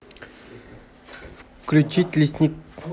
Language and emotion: Russian, neutral